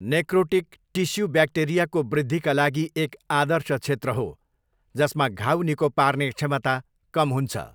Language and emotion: Nepali, neutral